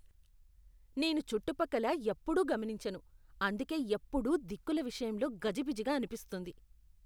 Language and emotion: Telugu, disgusted